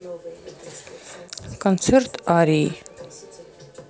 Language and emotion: Russian, neutral